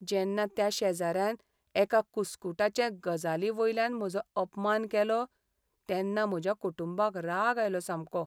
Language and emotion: Goan Konkani, sad